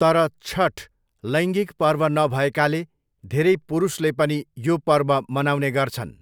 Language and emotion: Nepali, neutral